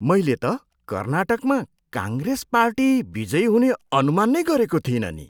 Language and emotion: Nepali, surprised